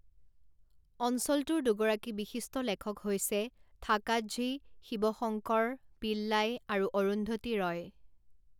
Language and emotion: Assamese, neutral